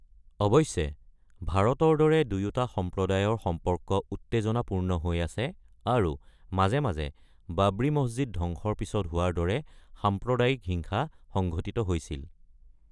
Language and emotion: Assamese, neutral